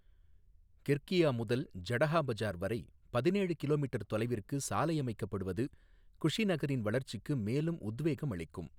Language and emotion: Tamil, neutral